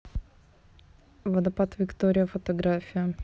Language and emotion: Russian, neutral